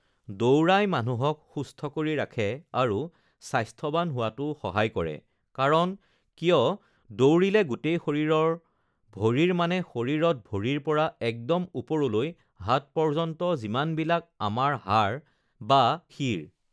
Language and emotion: Assamese, neutral